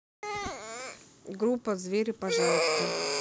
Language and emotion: Russian, neutral